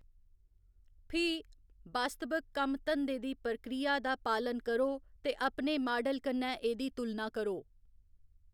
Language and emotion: Dogri, neutral